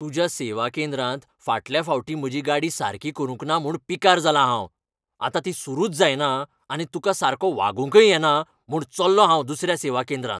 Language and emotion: Goan Konkani, angry